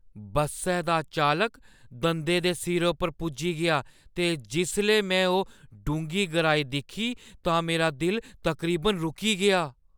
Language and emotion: Dogri, fearful